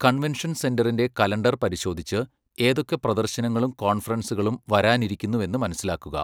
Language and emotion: Malayalam, neutral